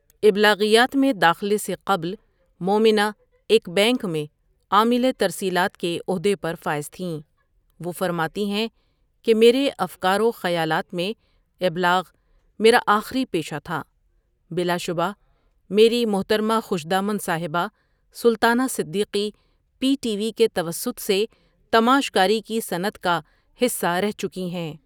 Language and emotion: Urdu, neutral